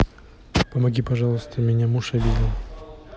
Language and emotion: Russian, neutral